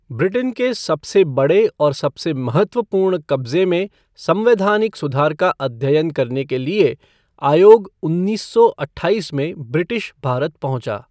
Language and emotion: Hindi, neutral